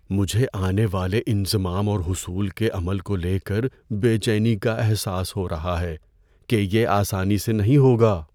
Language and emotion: Urdu, fearful